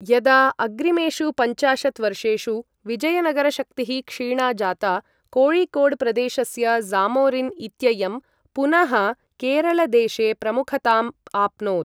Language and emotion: Sanskrit, neutral